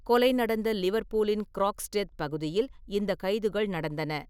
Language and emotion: Tamil, neutral